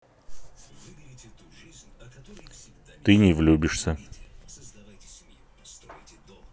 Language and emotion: Russian, neutral